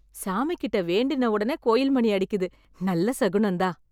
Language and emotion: Tamil, happy